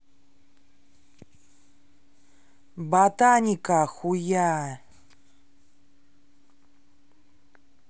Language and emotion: Russian, angry